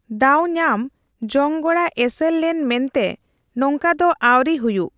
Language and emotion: Santali, neutral